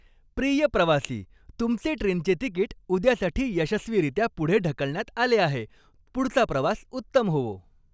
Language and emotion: Marathi, happy